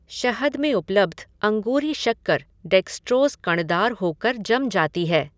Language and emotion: Hindi, neutral